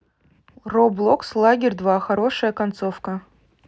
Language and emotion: Russian, neutral